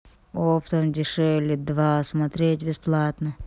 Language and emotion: Russian, sad